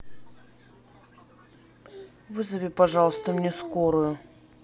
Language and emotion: Russian, sad